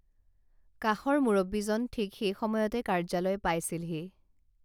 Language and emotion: Assamese, neutral